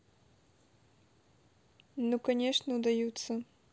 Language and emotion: Russian, neutral